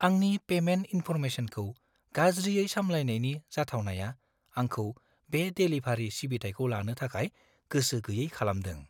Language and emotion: Bodo, fearful